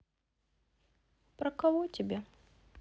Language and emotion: Russian, sad